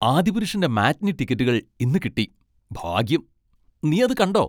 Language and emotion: Malayalam, happy